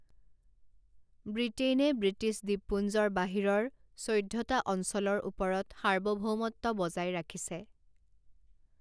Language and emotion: Assamese, neutral